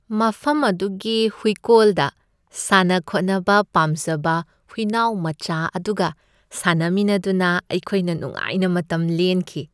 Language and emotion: Manipuri, happy